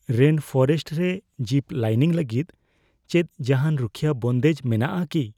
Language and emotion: Santali, fearful